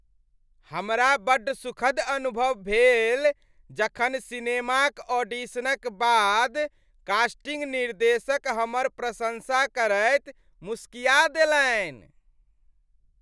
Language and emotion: Maithili, happy